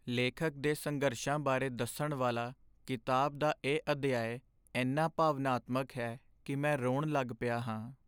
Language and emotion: Punjabi, sad